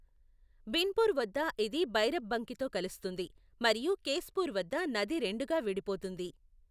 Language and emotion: Telugu, neutral